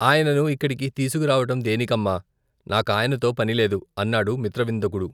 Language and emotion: Telugu, neutral